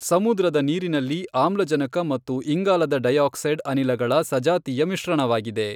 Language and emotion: Kannada, neutral